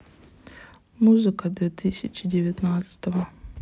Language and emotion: Russian, sad